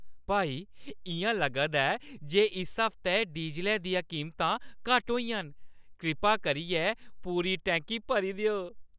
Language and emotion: Dogri, happy